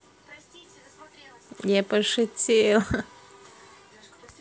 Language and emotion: Russian, positive